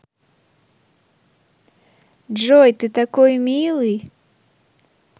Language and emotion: Russian, positive